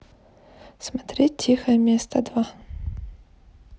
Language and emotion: Russian, neutral